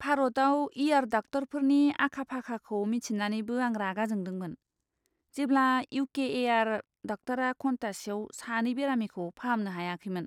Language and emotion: Bodo, disgusted